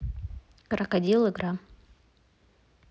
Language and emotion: Russian, neutral